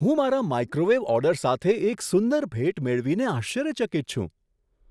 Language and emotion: Gujarati, surprised